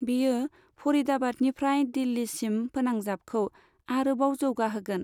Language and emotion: Bodo, neutral